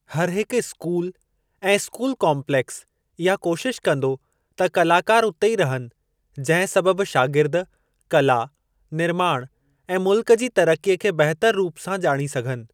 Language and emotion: Sindhi, neutral